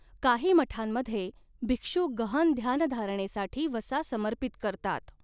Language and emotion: Marathi, neutral